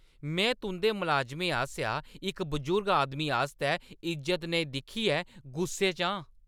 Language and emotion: Dogri, angry